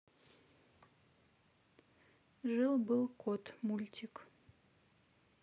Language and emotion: Russian, neutral